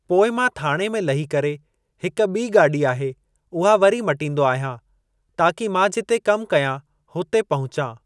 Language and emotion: Sindhi, neutral